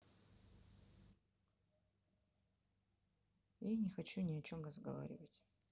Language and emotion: Russian, sad